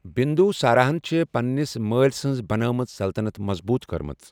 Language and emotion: Kashmiri, neutral